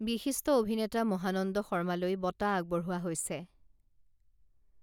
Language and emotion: Assamese, neutral